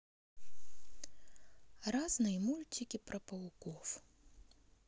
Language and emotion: Russian, neutral